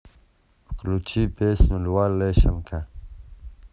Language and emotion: Russian, neutral